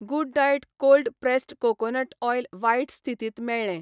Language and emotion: Goan Konkani, neutral